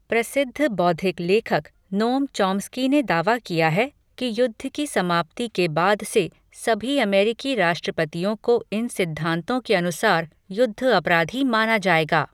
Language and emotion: Hindi, neutral